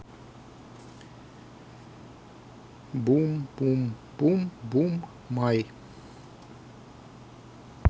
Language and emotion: Russian, neutral